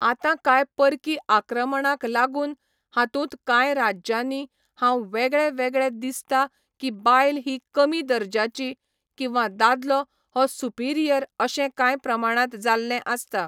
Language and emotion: Goan Konkani, neutral